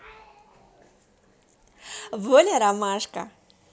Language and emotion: Russian, positive